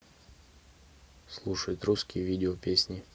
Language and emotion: Russian, neutral